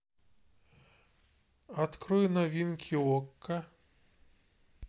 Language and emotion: Russian, neutral